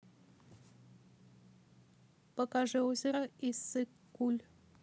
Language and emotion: Russian, neutral